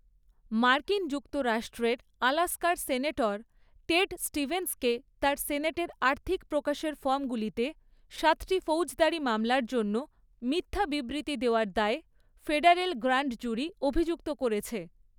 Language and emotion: Bengali, neutral